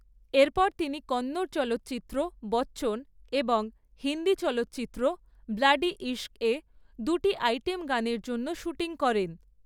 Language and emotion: Bengali, neutral